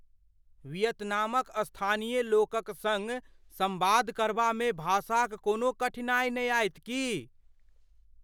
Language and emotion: Maithili, fearful